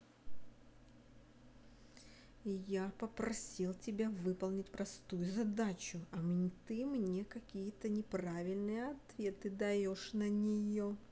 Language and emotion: Russian, angry